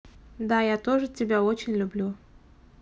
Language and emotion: Russian, neutral